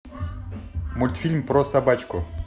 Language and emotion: Russian, positive